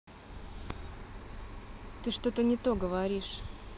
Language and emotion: Russian, angry